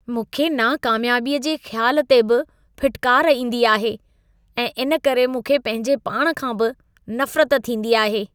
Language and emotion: Sindhi, disgusted